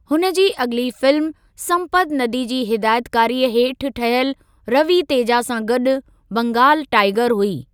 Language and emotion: Sindhi, neutral